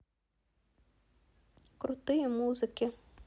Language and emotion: Russian, neutral